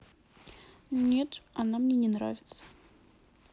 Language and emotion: Russian, neutral